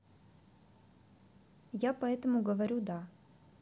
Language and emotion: Russian, neutral